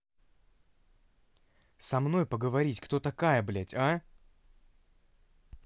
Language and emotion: Russian, angry